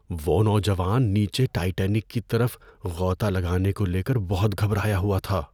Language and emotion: Urdu, fearful